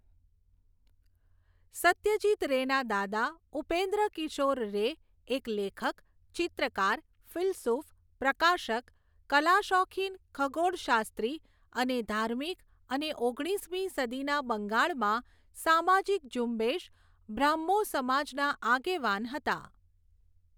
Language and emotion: Gujarati, neutral